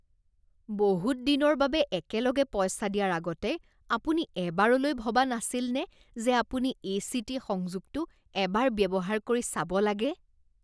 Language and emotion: Assamese, disgusted